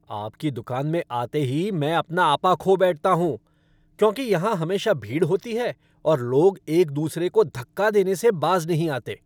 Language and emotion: Hindi, angry